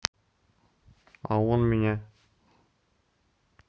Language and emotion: Russian, neutral